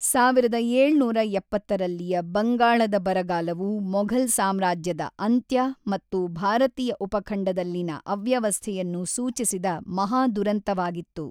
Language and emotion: Kannada, neutral